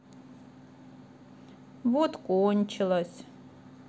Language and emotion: Russian, sad